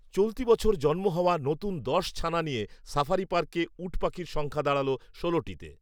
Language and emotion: Bengali, neutral